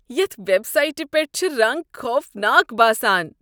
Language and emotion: Kashmiri, disgusted